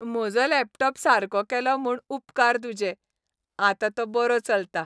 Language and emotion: Goan Konkani, happy